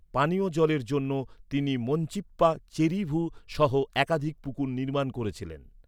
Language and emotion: Bengali, neutral